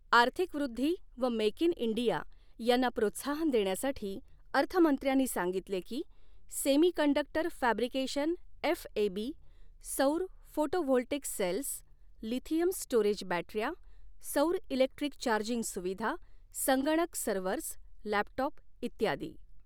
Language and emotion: Marathi, neutral